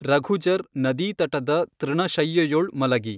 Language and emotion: Kannada, neutral